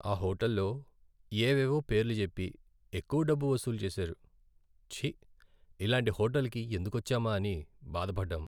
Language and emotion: Telugu, sad